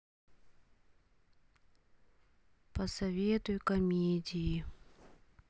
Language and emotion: Russian, sad